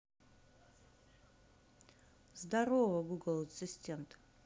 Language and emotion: Russian, neutral